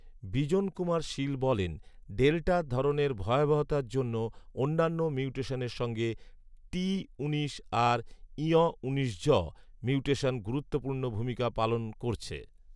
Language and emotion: Bengali, neutral